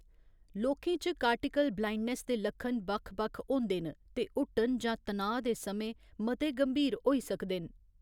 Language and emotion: Dogri, neutral